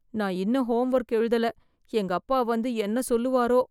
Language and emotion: Tamil, fearful